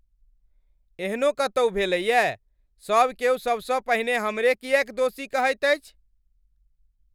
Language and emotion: Maithili, angry